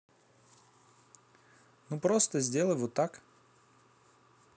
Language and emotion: Russian, neutral